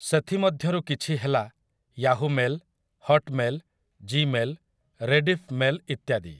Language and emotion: Odia, neutral